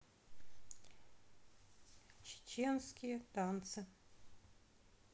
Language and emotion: Russian, sad